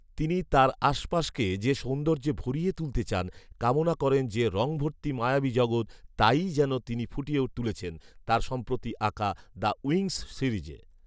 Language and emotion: Bengali, neutral